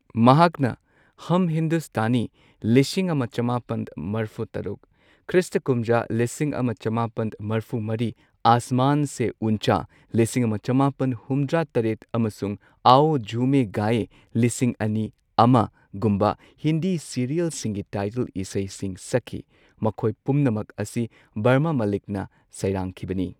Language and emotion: Manipuri, neutral